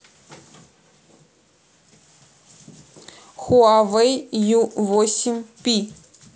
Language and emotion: Russian, neutral